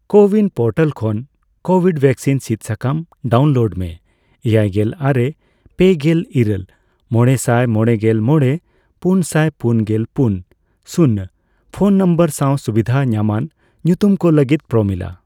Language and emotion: Santali, neutral